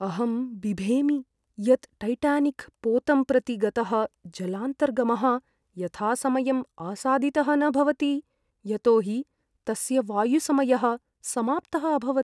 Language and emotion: Sanskrit, fearful